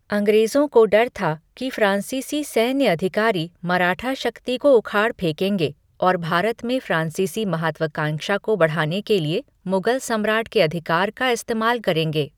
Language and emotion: Hindi, neutral